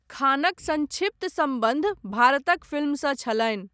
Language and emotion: Maithili, neutral